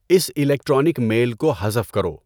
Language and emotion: Urdu, neutral